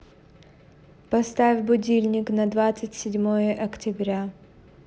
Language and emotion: Russian, neutral